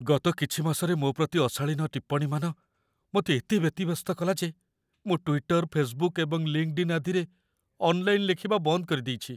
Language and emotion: Odia, fearful